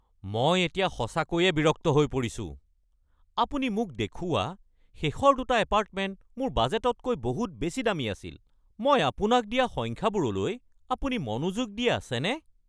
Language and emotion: Assamese, angry